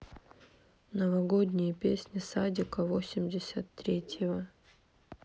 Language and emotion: Russian, sad